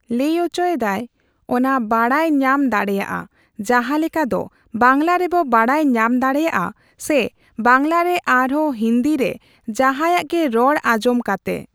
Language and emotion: Santali, neutral